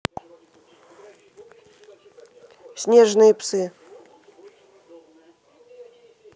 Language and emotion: Russian, neutral